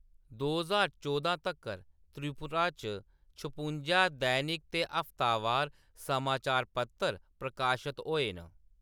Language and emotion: Dogri, neutral